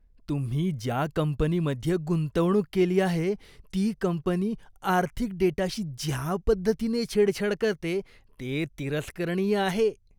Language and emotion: Marathi, disgusted